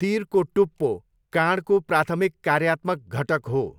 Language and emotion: Nepali, neutral